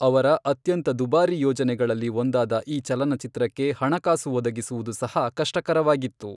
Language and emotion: Kannada, neutral